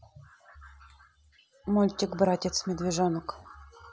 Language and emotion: Russian, neutral